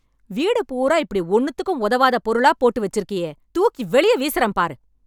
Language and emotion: Tamil, angry